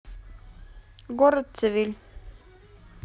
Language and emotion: Russian, neutral